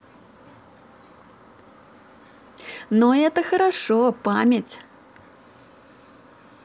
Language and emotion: Russian, positive